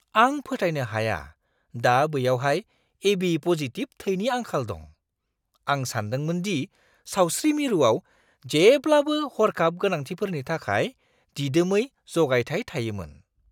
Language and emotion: Bodo, surprised